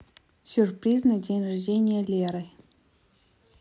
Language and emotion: Russian, neutral